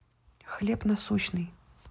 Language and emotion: Russian, neutral